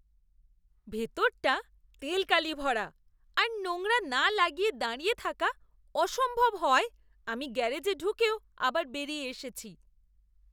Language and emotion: Bengali, disgusted